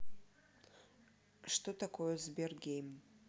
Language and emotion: Russian, neutral